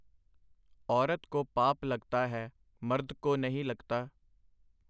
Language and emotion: Punjabi, neutral